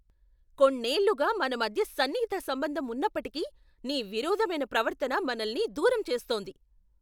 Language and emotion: Telugu, angry